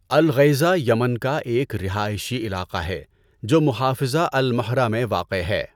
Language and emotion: Urdu, neutral